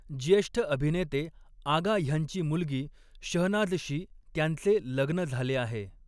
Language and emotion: Marathi, neutral